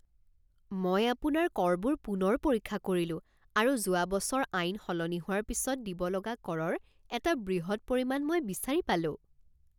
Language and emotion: Assamese, surprised